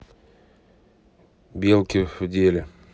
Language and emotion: Russian, neutral